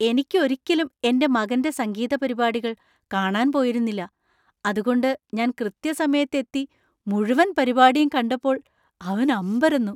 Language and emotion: Malayalam, surprised